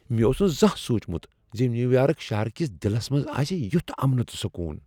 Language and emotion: Kashmiri, surprised